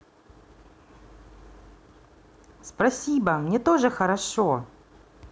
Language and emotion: Russian, positive